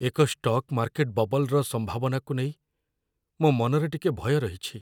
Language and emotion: Odia, fearful